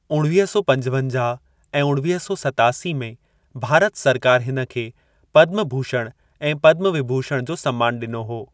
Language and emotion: Sindhi, neutral